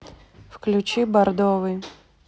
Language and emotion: Russian, neutral